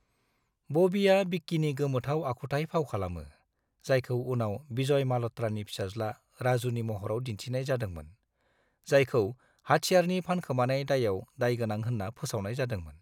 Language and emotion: Bodo, neutral